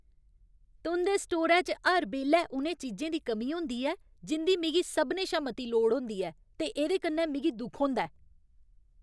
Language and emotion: Dogri, angry